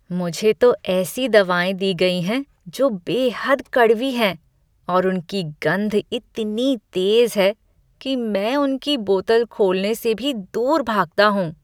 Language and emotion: Hindi, disgusted